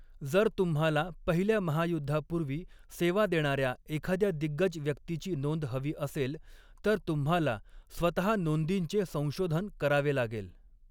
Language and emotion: Marathi, neutral